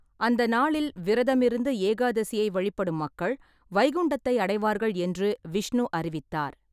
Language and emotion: Tamil, neutral